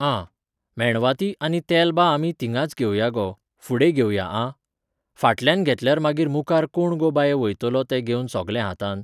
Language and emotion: Goan Konkani, neutral